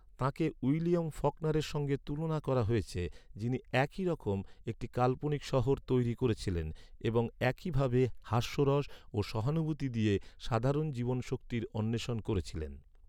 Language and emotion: Bengali, neutral